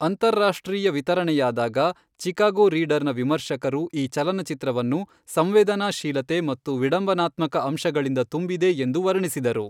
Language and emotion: Kannada, neutral